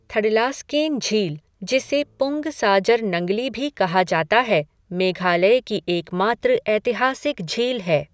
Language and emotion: Hindi, neutral